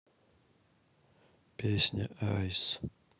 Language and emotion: Russian, sad